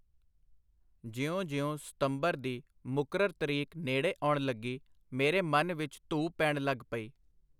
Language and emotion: Punjabi, neutral